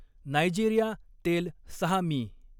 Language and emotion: Marathi, neutral